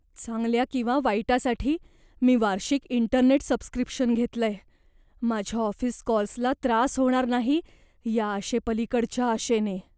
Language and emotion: Marathi, fearful